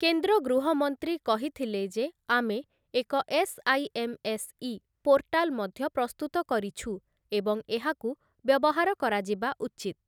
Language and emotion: Odia, neutral